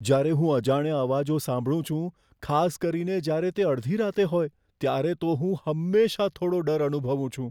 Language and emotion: Gujarati, fearful